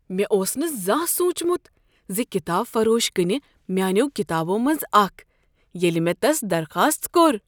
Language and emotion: Kashmiri, surprised